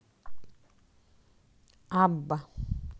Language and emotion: Russian, neutral